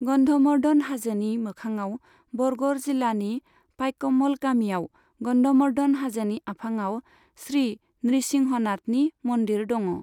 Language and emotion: Bodo, neutral